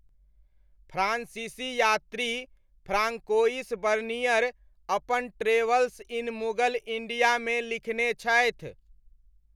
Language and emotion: Maithili, neutral